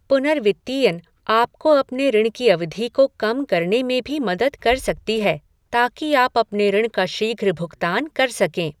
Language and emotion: Hindi, neutral